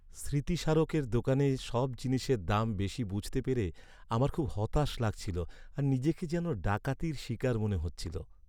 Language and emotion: Bengali, sad